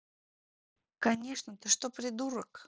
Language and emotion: Russian, neutral